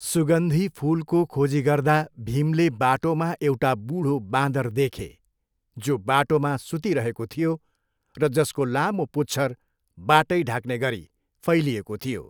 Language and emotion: Nepali, neutral